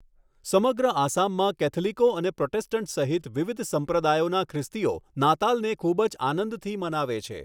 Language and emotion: Gujarati, neutral